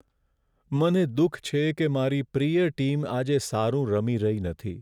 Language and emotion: Gujarati, sad